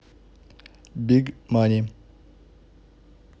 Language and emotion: Russian, neutral